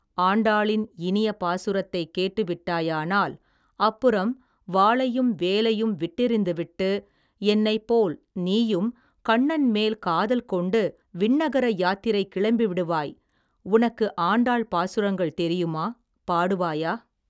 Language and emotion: Tamil, neutral